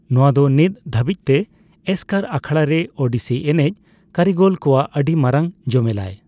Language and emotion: Santali, neutral